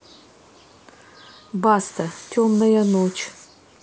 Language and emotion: Russian, neutral